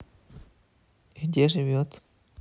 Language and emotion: Russian, neutral